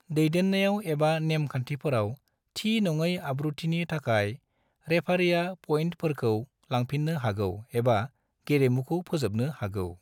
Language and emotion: Bodo, neutral